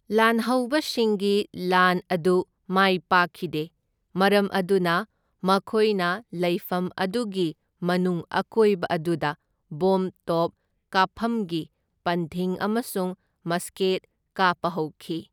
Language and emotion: Manipuri, neutral